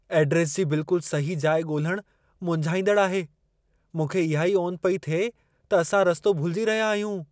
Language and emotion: Sindhi, fearful